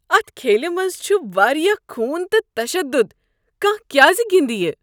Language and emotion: Kashmiri, disgusted